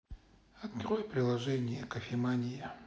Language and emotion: Russian, neutral